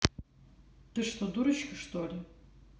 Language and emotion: Russian, neutral